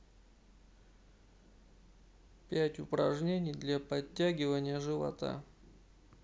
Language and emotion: Russian, neutral